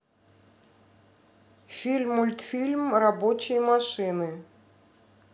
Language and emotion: Russian, neutral